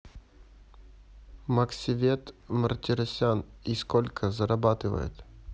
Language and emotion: Russian, neutral